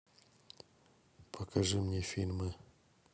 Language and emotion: Russian, neutral